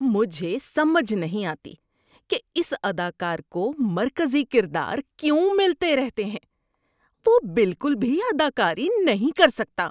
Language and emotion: Urdu, disgusted